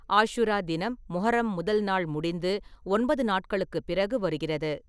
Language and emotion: Tamil, neutral